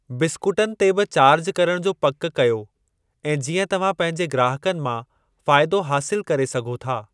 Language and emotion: Sindhi, neutral